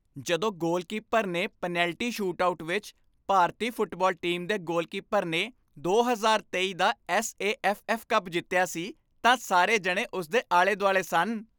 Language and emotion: Punjabi, happy